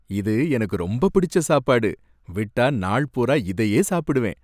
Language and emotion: Tamil, happy